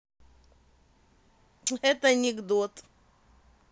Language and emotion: Russian, positive